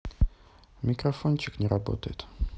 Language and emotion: Russian, neutral